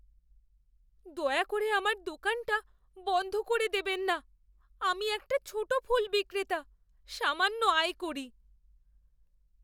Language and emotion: Bengali, fearful